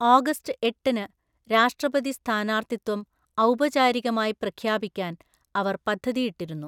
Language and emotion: Malayalam, neutral